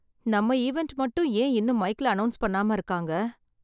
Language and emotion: Tamil, sad